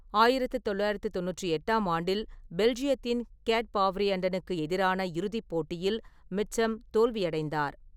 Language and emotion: Tamil, neutral